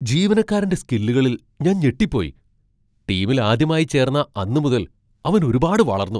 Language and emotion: Malayalam, surprised